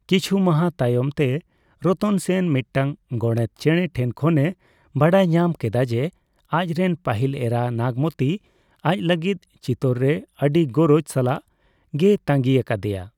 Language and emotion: Santali, neutral